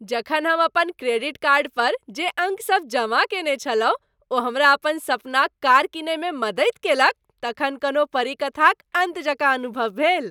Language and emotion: Maithili, happy